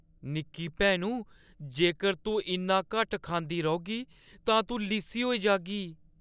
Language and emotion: Dogri, fearful